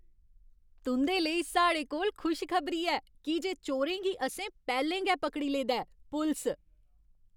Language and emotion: Dogri, happy